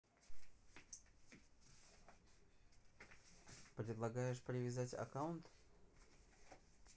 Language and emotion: Russian, neutral